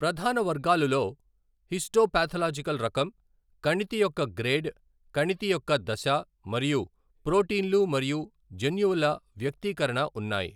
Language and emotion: Telugu, neutral